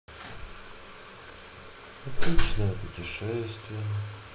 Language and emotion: Russian, sad